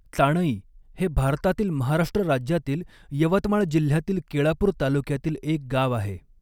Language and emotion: Marathi, neutral